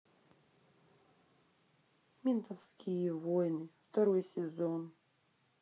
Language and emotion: Russian, sad